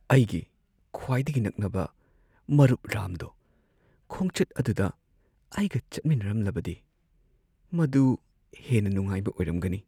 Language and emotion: Manipuri, sad